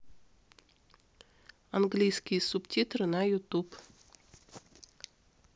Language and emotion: Russian, neutral